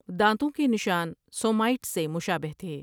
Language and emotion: Urdu, neutral